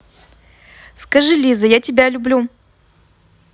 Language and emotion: Russian, positive